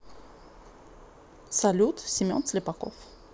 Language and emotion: Russian, neutral